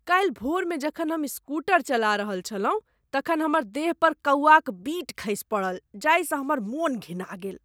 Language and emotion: Maithili, disgusted